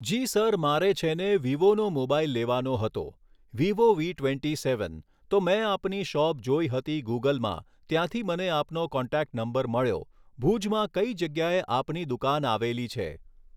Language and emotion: Gujarati, neutral